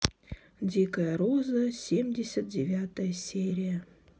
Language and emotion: Russian, neutral